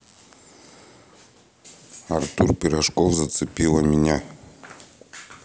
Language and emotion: Russian, neutral